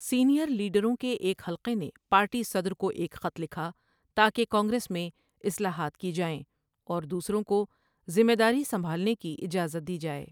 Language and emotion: Urdu, neutral